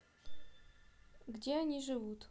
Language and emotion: Russian, neutral